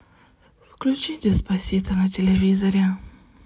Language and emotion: Russian, sad